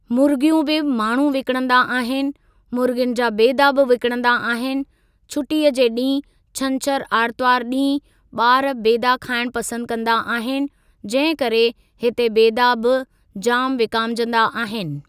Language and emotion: Sindhi, neutral